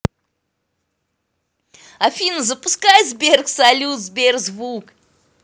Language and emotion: Russian, positive